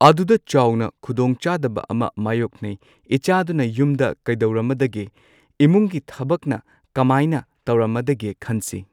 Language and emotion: Manipuri, neutral